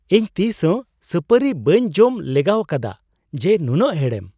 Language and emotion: Santali, surprised